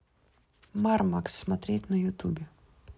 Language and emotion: Russian, neutral